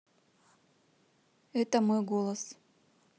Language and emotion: Russian, neutral